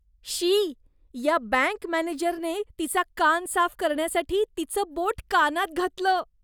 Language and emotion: Marathi, disgusted